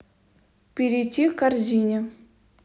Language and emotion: Russian, neutral